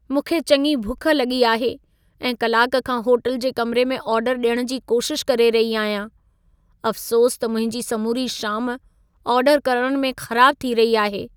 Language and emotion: Sindhi, sad